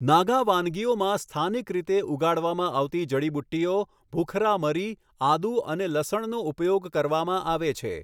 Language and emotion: Gujarati, neutral